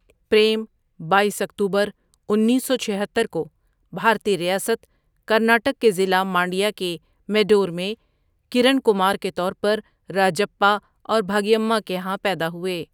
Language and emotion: Urdu, neutral